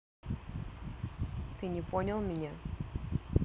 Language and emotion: Russian, neutral